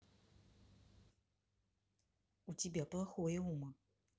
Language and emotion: Russian, neutral